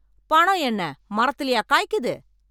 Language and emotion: Tamil, angry